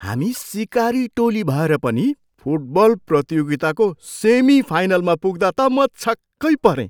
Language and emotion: Nepali, surprised